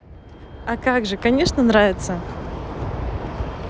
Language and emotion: Russian, positive